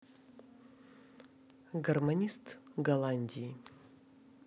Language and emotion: Russian, neutral